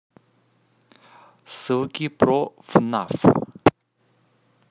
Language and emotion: Russian, neutral